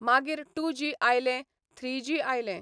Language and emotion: Goan Konkani, neutral